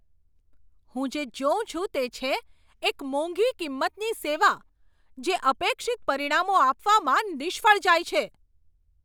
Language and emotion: Gujarati, angry